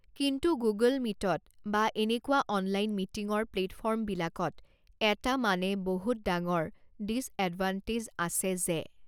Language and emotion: Assamese, neutral